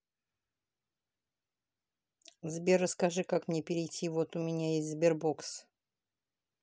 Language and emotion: Russian, neutral